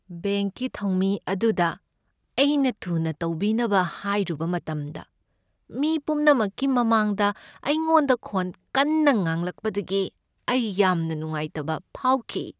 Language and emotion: Manipuri, sad